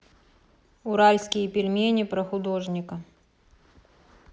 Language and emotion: Russian, neutral